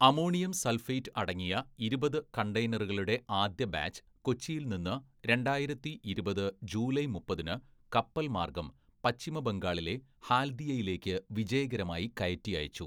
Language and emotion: Malayalam, neutral